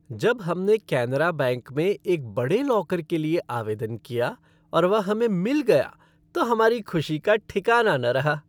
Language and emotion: Hindi, happy